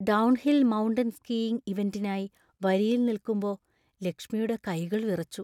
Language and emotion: Malayalam, fearful